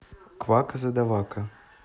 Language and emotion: Russian, neutral